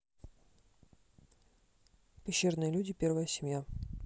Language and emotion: Russian, neutral